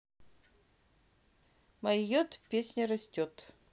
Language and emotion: Russian, neutral